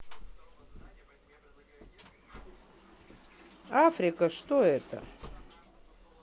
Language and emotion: Russian, neutral